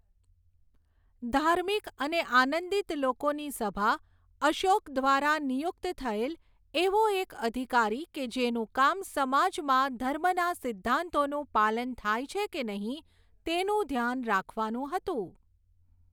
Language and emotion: Gujarati, neutral